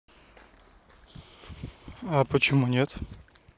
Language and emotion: Russian, neutral